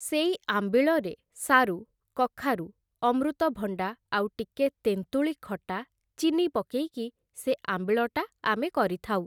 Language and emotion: Odia, neutral